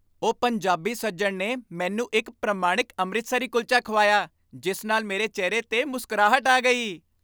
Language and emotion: Punjabi, happy